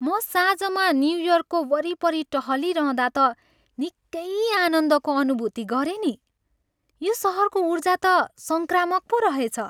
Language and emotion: Nepali, happy